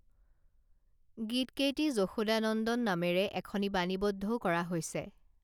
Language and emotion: Assamese, neutral